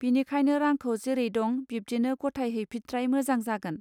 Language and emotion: Bodo, neutral